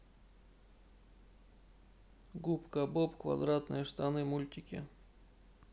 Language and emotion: Russian, neutral